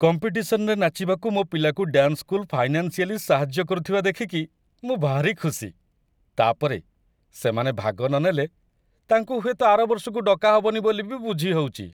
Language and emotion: Odia, happy